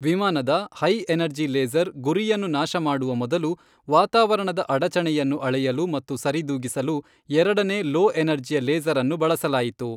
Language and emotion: Kannada, neutral